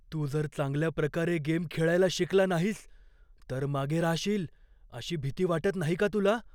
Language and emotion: Marathi, fearful